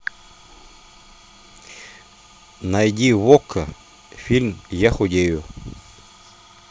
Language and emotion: Russian, neutral